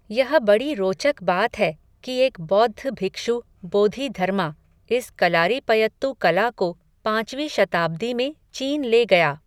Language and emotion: Hindi, neutral